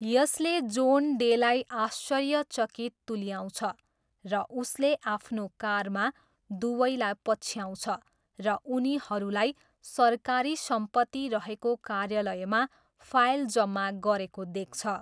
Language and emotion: Nepali, neutral